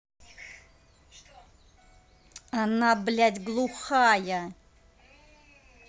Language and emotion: Russian, angry